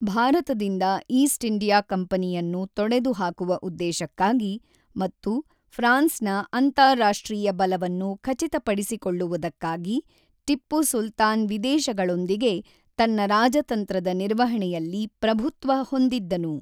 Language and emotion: Kannada, neutral